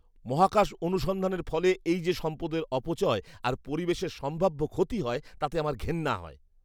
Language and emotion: Bengali, disgusted